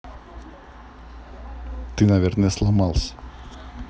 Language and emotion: Russian, neutral